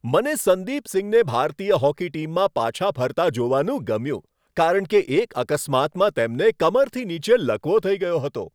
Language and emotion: Gujarati, happy